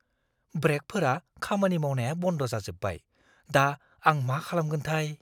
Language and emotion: Bodo, fearful